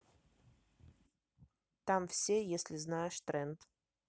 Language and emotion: Russian, neutral